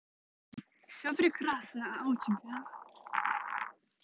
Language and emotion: Russian, positive